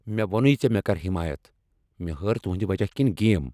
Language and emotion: Kashmiri, angry